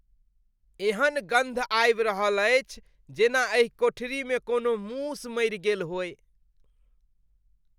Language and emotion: Maithili, disgusted